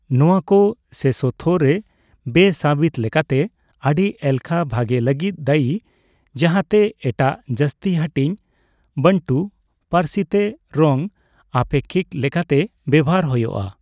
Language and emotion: Santali, neutral